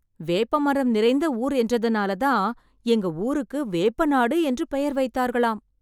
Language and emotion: Tamil, surprised